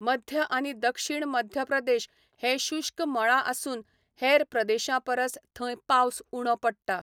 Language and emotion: Goan Konkani, neutral